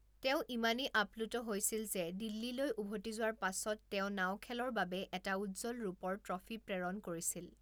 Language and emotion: Assamese, neutral